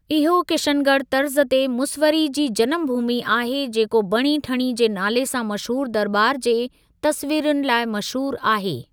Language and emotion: Sindhi, neutral